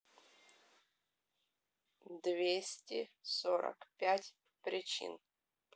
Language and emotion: Russian, neutral